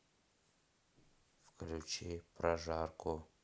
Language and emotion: Russian, neutral